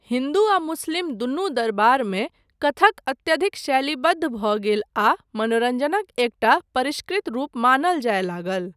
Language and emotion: Maithili, neutral